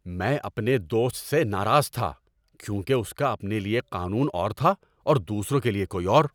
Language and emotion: Urdu, angry